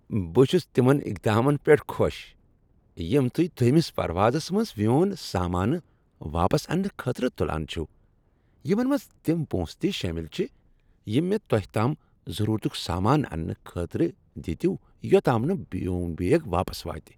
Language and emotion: Kashmiri, happy